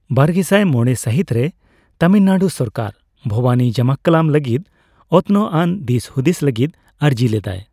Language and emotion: Santali, neutral